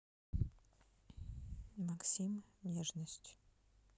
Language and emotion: Russian, neutral